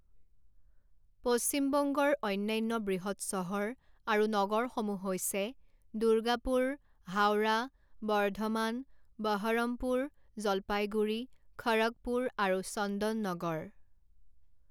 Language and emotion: Assamese, neutral